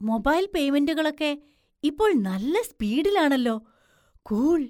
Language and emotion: Malayalam, surprised